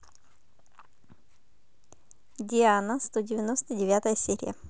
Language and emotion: Russian, positive